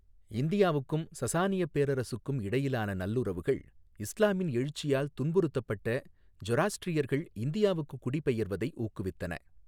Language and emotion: Tamil, neutral